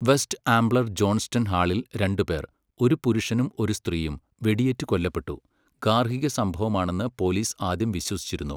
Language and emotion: Malayalam, neutral